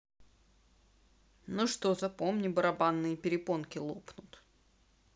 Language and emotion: Russian, neutral